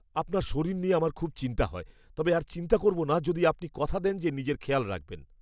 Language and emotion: Bengali, fearful